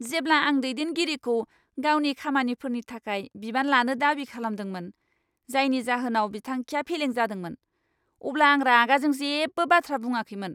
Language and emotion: Bodo, angry